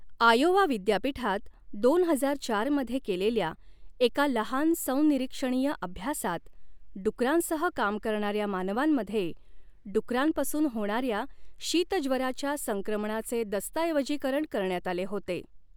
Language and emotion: Marathi, neutral